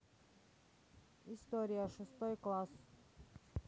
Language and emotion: Russian, neutral